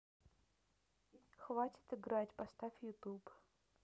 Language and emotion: Russian, neutral